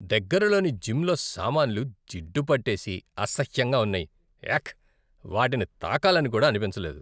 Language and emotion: Telugu, disgusted